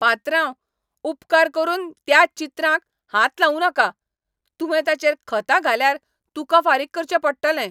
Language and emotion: Goan Konkani, angry